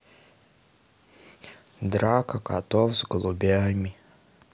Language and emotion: Russian, sad